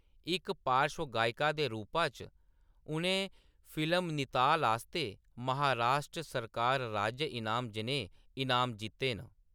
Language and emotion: Dogri, neutral